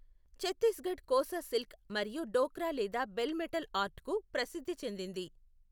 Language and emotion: Telugu, neutral